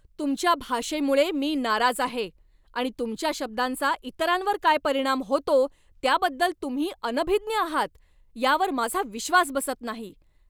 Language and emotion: Marathi, angry